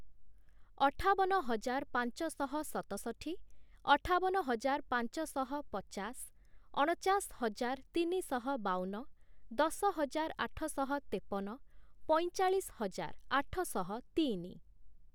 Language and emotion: Odia, neutral